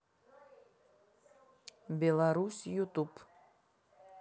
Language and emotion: Russian, neutral